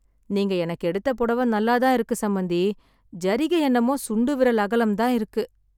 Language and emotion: Tamil, sad